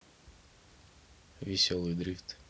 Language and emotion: Russian, neutral